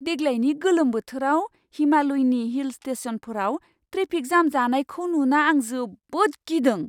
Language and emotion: Bodo, surprised